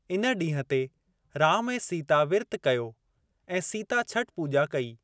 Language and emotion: Sindhi, neutral